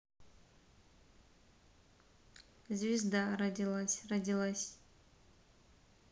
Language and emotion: Russian, neutral